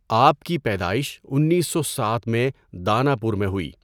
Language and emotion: Urdu, neutral